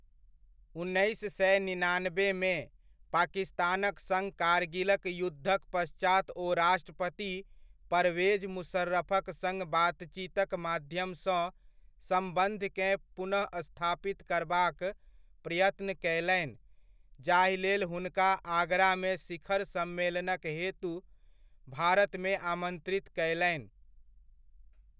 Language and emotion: Maithili, neutral